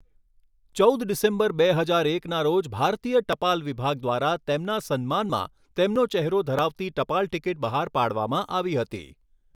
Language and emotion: Gujarati, neutral